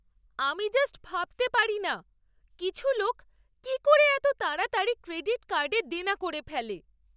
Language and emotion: Bengali, surprised